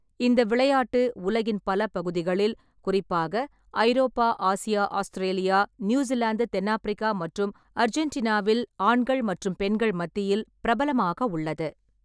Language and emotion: Tamil, neutral